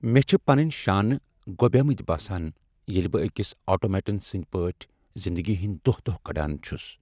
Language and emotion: Kashmiri, sad